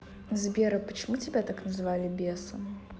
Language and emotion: Russian, neutral